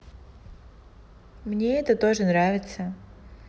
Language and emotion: Russian, neutral